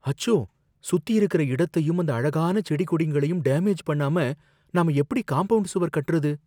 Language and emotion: Tamil, fearful